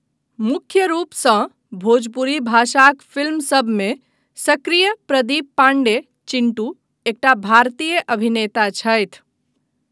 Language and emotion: Maithili, neutral